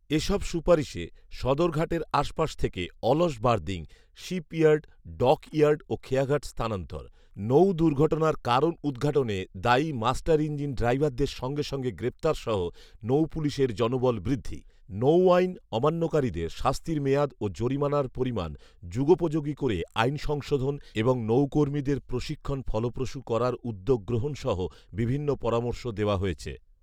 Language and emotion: Bengali, neutral